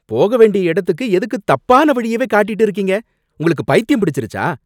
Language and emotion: Tamil, angry